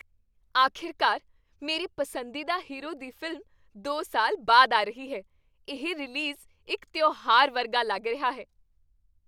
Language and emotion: Punjabi, happy